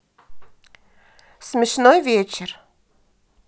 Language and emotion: Russian, neutral